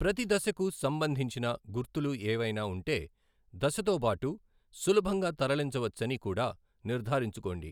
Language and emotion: Telugu, neutral